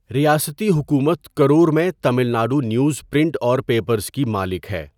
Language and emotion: Urdu, neutral